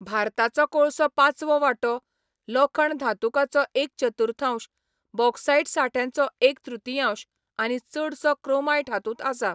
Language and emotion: Goan Konkani, neutral